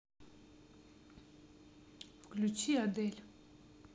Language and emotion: Russian, neutral